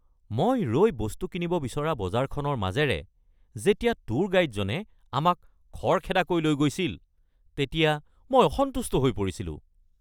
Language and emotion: Assamese, angry